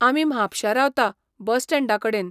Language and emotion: Goan Konkani, neutral